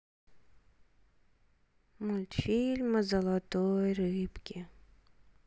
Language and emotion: Russian, sad